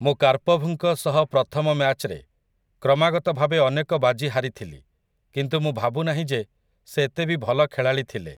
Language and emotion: Odia, neutral